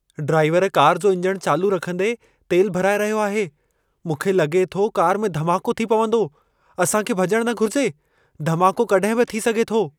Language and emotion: Sindhi, fearful